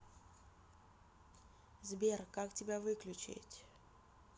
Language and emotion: Russian, neutral